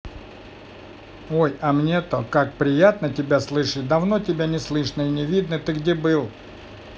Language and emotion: Russian, positive